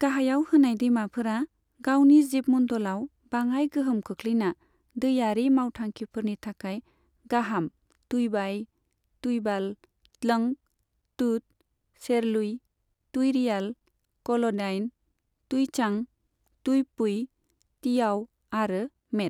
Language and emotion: Bodo, neutral